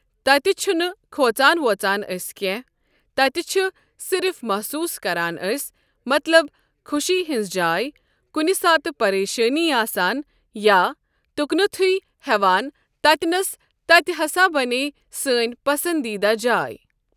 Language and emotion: Kashmiri, neutral